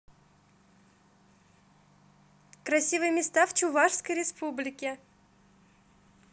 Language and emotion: Russian, positive